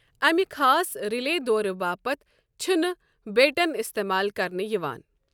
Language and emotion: Kashmiri, neutral